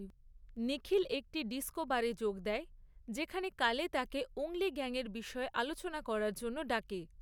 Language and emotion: Bengali, neutral